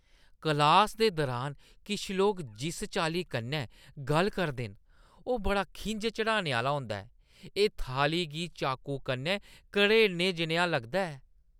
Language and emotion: Dogri, disgusted